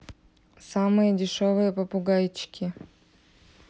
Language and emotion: Russian, neutral